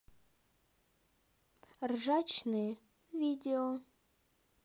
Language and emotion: Russian, neutral